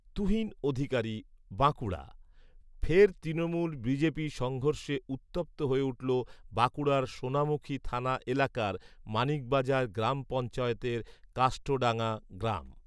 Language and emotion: Bengali, neutral